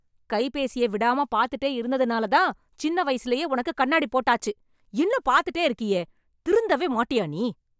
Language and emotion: Tamil, angry